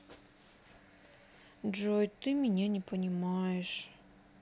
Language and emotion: Russian, sad